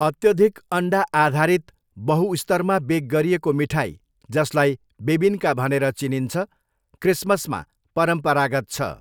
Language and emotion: Nepali, neutral